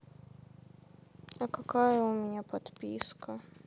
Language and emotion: Russian, sad